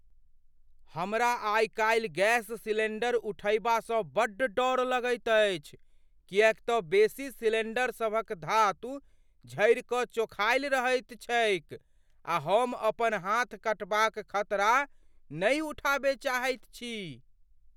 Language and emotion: Maithili, fearful